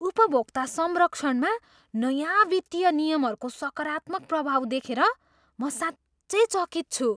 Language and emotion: Nepali, surprised